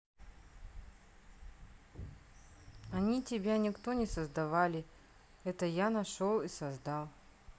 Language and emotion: Russian, neutral